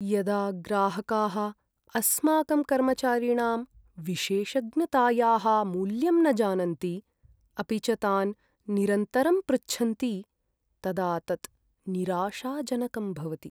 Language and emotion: Sanskrit, sad